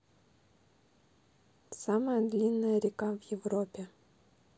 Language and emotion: Russian, neutral